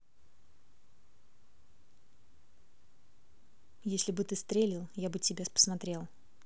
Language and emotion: Russian, neutral